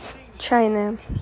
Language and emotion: Russian, neutral